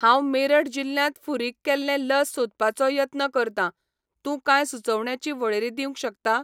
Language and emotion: Goan Konkani, neutral